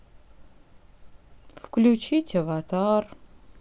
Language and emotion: Russian, sad